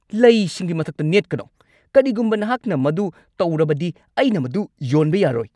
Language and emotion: Manipuri, angry